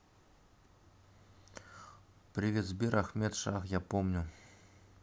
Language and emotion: Russian, neutral